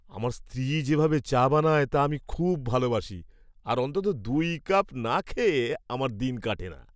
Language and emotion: Bengali, happy